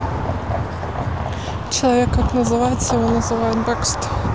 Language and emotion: Russian, neutral